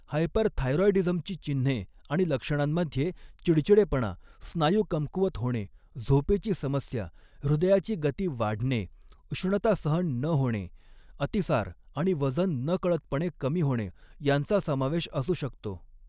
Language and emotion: Marathi, neutral